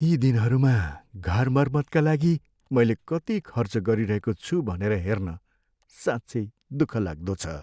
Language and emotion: Nepali, sad